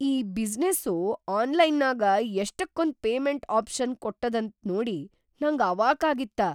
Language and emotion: Kannada, surprised